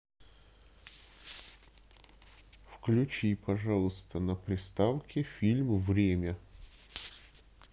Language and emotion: Russian, neutral